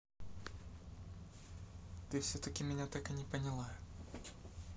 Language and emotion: Russian, neutral